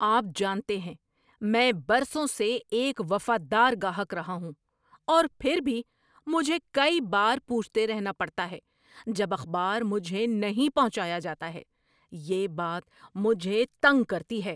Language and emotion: Urdu, angry